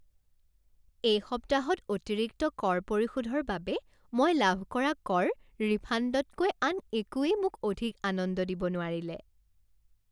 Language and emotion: Assamese, happy